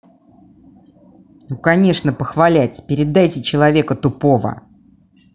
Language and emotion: Russian, angry